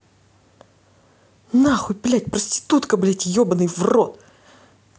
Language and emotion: Russian, angry